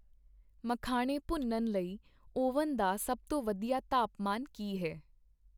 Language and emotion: Punjabi, neutral